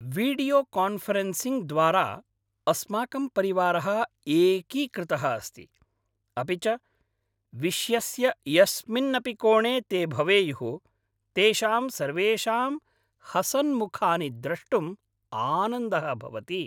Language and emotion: Sanskrit, happy